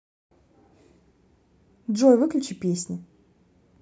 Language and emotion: Russian, neutral